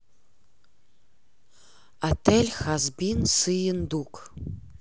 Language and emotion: Russian, neutral